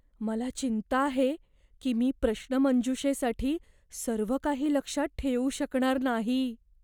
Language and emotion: Marathi, fearful